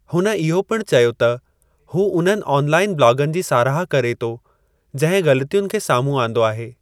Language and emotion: Sindhi, neutral